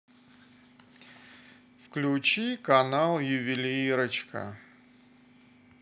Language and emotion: Russian, sad